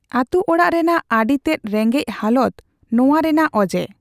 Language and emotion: Santali, neutral